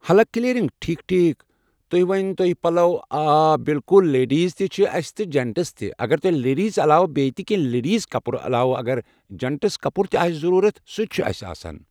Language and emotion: Kashmiri, neutral